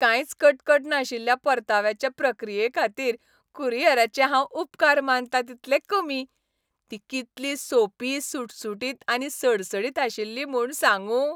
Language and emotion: Goan Konkani, happy